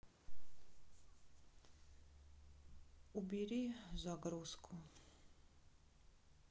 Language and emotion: Russian, sad